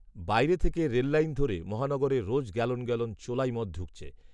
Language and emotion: Bengali, neutral